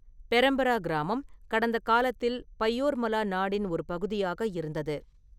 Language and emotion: Tamil, neutral